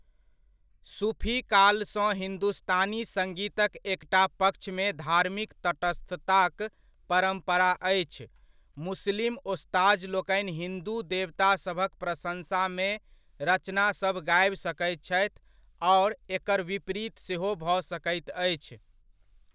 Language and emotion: Maithili, neutral